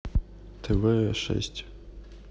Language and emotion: Russian, neutral